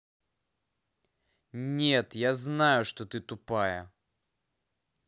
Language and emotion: Russian, angry